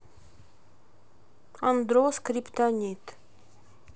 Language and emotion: Russian, neutral